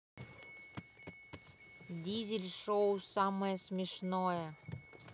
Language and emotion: Russian, neutral